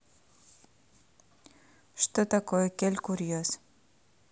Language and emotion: Russian, neutral